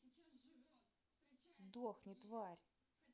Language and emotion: Russian, angry